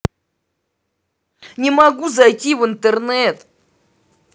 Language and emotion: Russian, angry